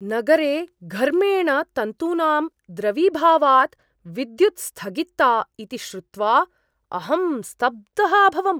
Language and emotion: Sanskrit, surprised